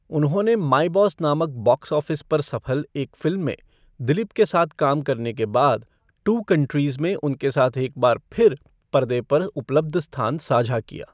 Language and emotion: Hindi, neutral